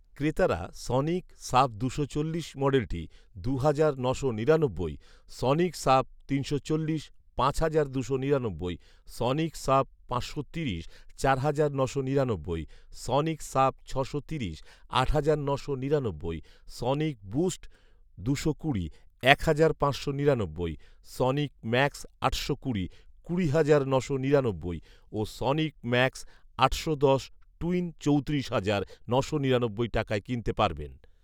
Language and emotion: Bengali, neutral